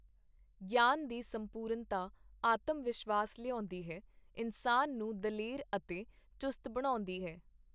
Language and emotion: Punjabi, neutral